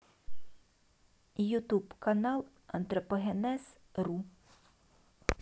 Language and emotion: Russian, neutral